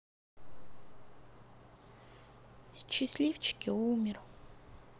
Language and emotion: Russian, sad